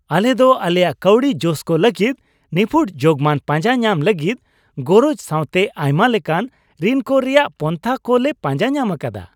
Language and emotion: Santali, happy